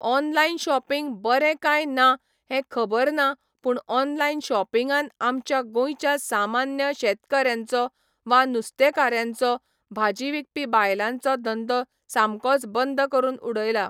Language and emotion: Goan Konkani, neutral